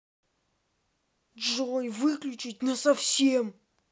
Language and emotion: Russian, angry